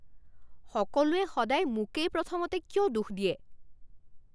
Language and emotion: Assamese, angry